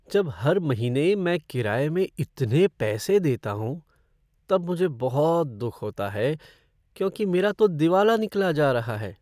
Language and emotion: Hindi, sad